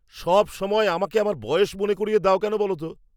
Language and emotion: Bengali, angry